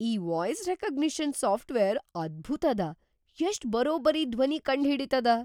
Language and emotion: Kannada, surprised